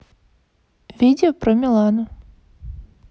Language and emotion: Russian, neutral